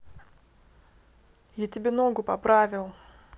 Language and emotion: Russian, neutral